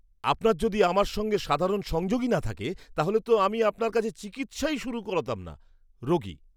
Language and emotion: Bengali, disgusted